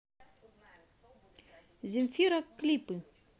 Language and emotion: Russian, positive